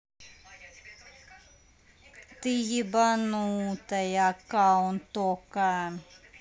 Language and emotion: Russian, neutral